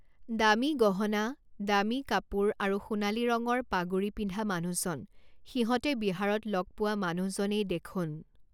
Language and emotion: Assamese, neutral